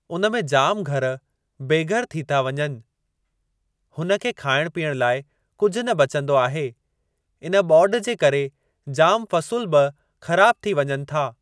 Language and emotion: Sindhi, neutral